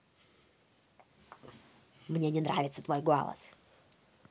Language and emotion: Russian, angry